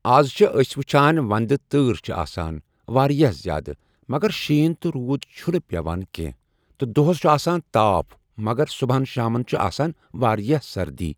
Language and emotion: Kashmiri, neutral